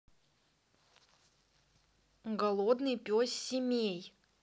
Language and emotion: Russian, neutral